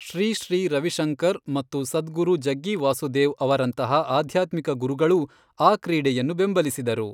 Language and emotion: Kannada, neutral